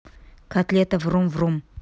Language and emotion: Russian, neutral